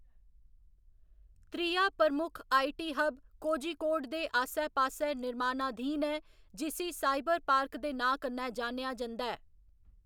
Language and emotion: Dogri, neutral